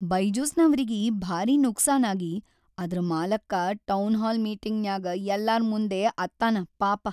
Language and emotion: Kannada, sad